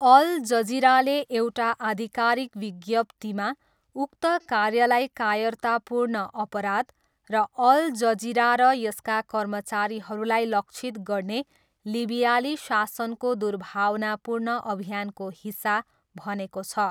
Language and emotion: Nepali, neutral